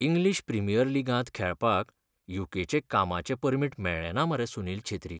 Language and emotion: Goan Konkani, sad